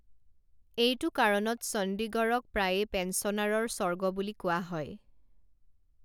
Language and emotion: Assamese, neutral